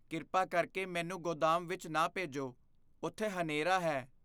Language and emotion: Punjabi, fearful